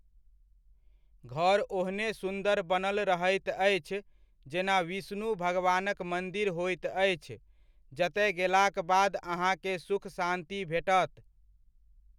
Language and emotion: Maithili, neutral